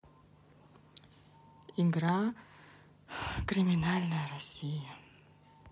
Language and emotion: Russian, sad